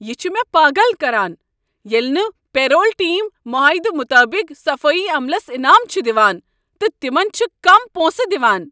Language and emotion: Kashmiri, angry